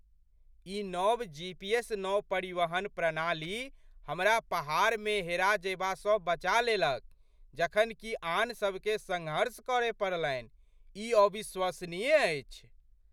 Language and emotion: Maithili, surprised